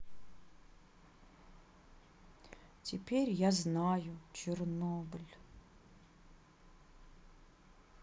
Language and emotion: Russian, sad